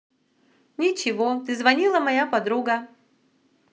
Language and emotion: Russian, positive